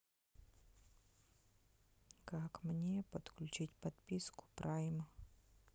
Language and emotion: Russian, neutral